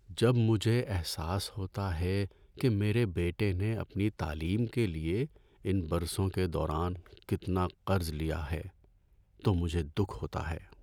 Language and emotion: Urdu, sad